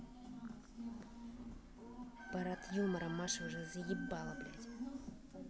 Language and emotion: Russian, angry